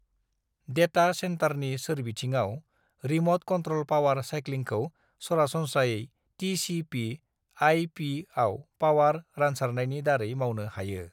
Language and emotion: Bodo, neutral